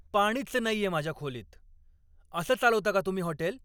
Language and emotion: Marathi, angry